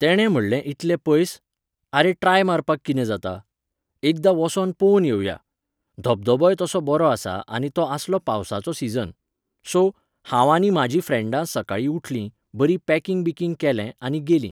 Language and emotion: Goan Konkani, neutral